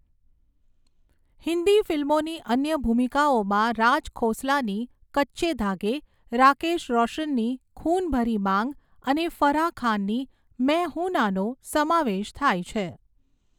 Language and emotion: Gujarati, neutral